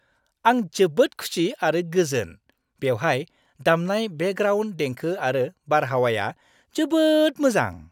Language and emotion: Bodo, happy